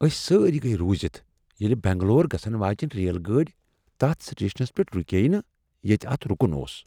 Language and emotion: Kashmiri, surprised